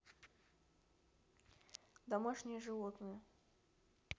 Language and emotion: Russian, neutral